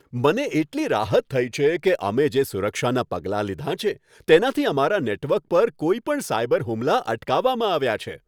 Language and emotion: Gujarati, happy